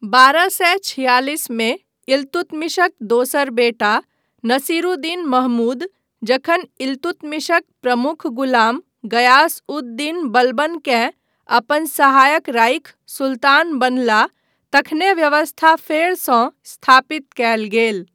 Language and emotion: Maithili, neutral